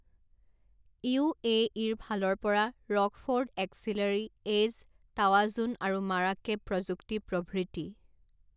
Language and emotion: Assamese, neutral